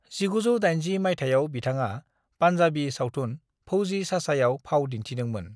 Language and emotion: Bodo, neutral